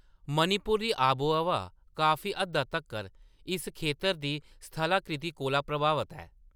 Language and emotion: Dogri, neutral